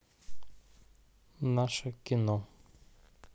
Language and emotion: Russian, neutral